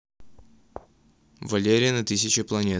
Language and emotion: Russian, neutral